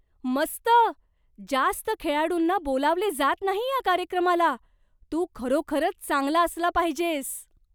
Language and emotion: Marathi, surprised